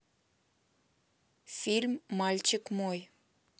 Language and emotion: Russian, neutral